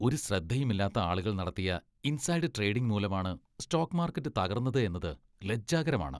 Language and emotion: Malayalam, disgusted